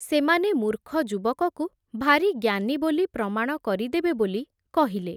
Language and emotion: Odia, neutral